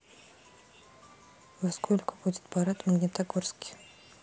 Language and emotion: Russian, neutral